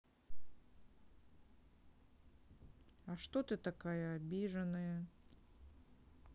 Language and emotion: Russian, sad